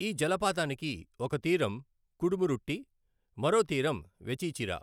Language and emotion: Telugu, neutral